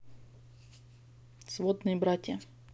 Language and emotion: Russian, neutral